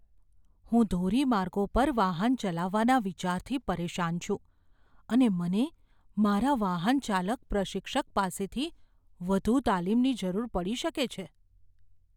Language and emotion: Gujarati, fearful